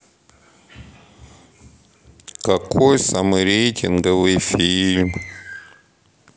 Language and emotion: Russian, sad